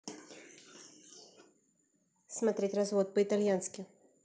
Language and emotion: Russian, neutral